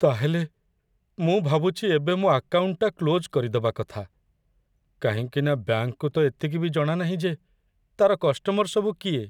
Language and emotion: Odia, sad